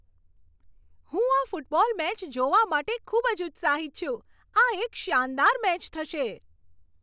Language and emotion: Gujarati, happy